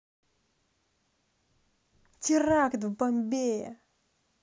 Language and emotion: Russian, positive